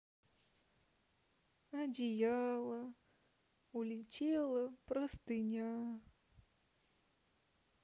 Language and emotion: Russian, sad